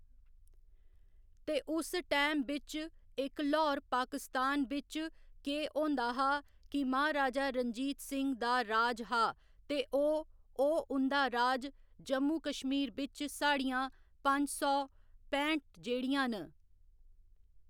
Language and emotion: Dogri, neutral